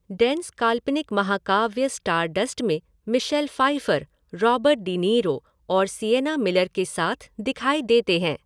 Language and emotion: Hindi, neutral